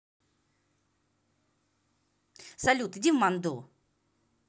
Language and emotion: Russian, angry